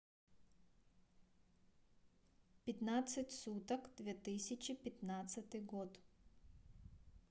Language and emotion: Russian, neutral